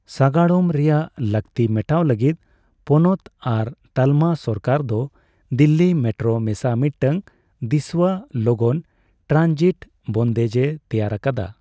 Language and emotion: Santali, neutral